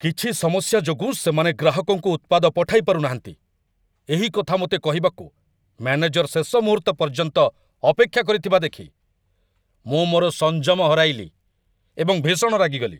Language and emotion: Odia, angry